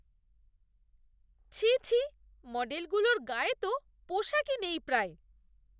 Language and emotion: Bengali, disgusted